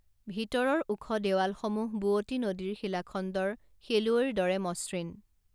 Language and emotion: Assamese, neutral